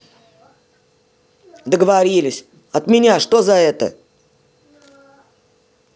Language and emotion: Russian, angry